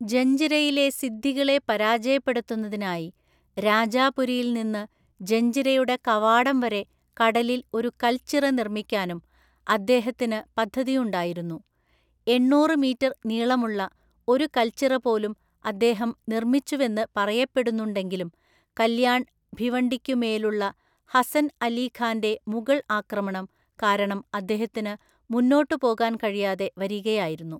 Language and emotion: Malayalam, neutral